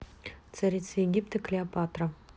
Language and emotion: Russian, neutral